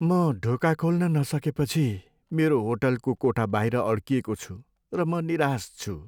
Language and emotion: Nepali, sad